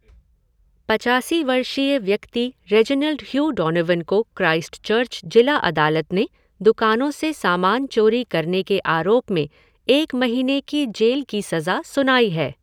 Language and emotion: Hindi, neutral